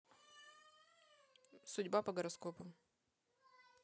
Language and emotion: Russian, neutral